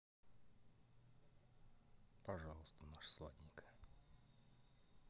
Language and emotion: Russian, sad